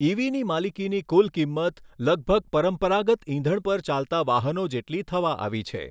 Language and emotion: Gujarati, neutral